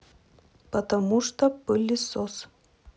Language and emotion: Russian, neutral